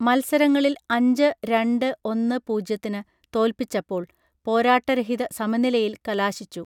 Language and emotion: Malayalam, neutral